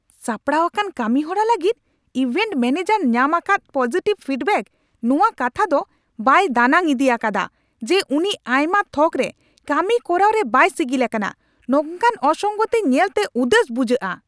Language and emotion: Santali, angry